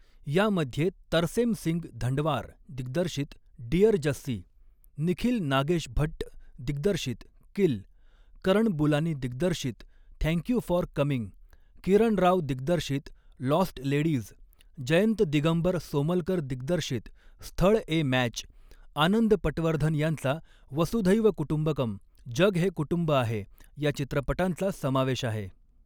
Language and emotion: Marathi, neutral